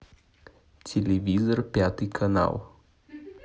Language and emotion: Russian, neutral